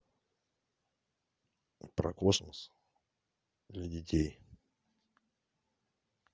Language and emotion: Russian, neutral